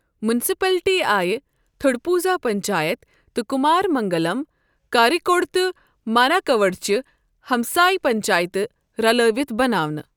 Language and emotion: Kashmiri, neutral